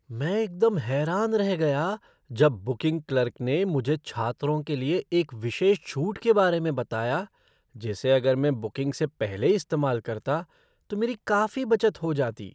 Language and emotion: Hindi, surprised